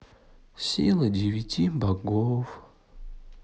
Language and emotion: Russian, sad